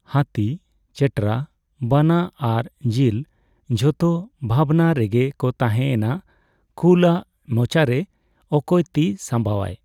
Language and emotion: Santali, neutral